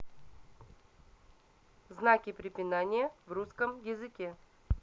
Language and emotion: Russian, neutral